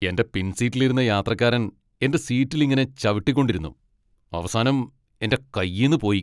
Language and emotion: Malayalam, angry